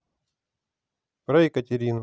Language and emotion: Russian, neutral